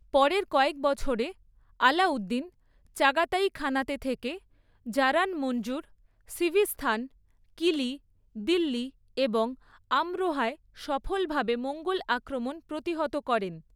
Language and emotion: Bengali, neutral